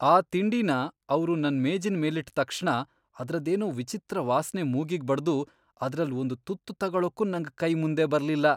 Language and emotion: Kannada, disgusted